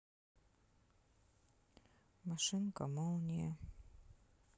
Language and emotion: Russian, sad